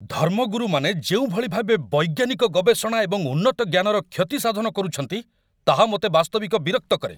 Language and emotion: Odia, angry